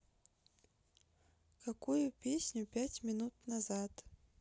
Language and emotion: Russian, neutral